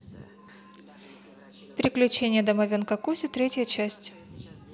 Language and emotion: Russian, neutral